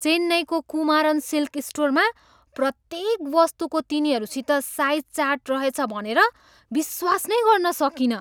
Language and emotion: Nepali, surprised